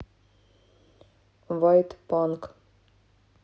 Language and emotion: Russian, neutral